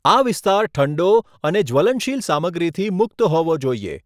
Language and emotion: Gujarati, neutral